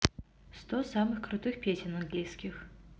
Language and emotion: Russian, neutral